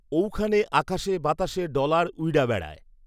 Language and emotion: Bengali, neutral